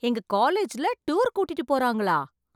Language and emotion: Tamil, surprised